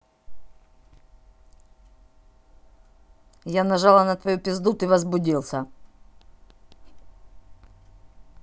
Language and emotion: Russian, neutral